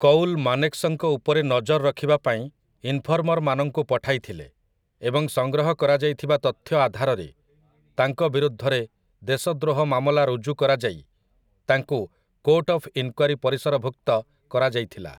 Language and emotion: Odia, neutral